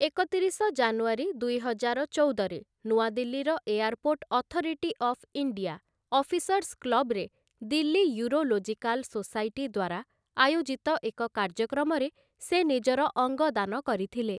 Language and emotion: Odia, neutral